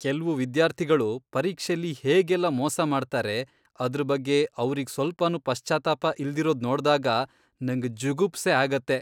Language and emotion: Kannada, disgusted